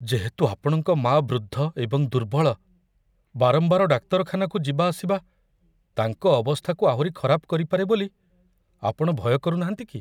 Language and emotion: Odia, fearful